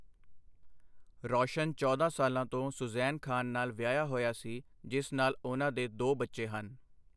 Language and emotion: Punjabi, neutral